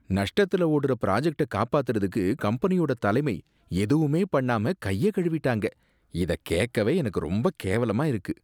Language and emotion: Tamil, disgusted